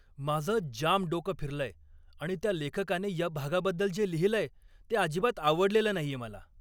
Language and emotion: Marathi, angry